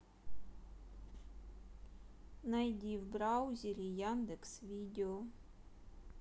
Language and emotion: Russian, neutral